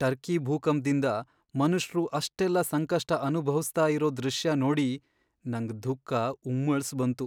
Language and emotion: Kannada, sad